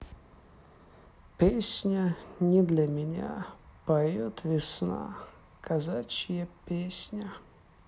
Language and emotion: Russian, sad